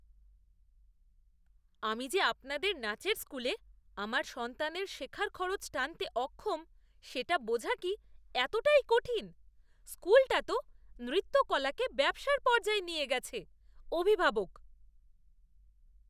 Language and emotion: Bengali, disgusted